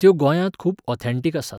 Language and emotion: Goan Konkani, neutral